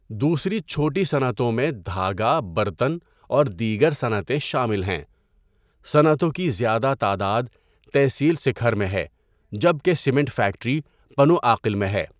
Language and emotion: Urdu, neutral